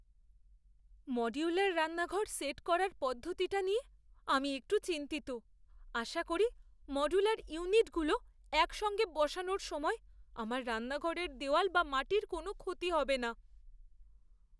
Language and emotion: Bengali, fearful